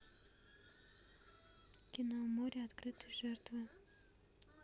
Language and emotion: Russian, neutral